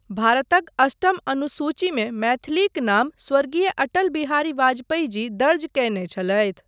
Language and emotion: Maithili, neutral